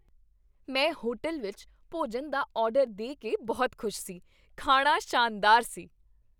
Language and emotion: Punjabi, happy